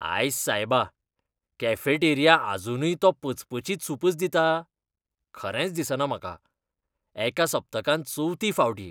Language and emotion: Goan Konkani, disgusted